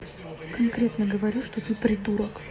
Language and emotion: Russian, angry